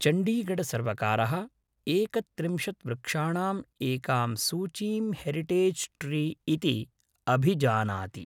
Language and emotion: Sanskrit, neutral